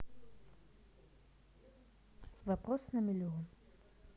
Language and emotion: Russian, neutral